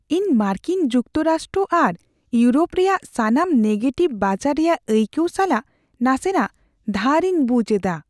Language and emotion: Santali, fearful